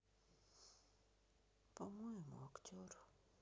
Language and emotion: Russian, sad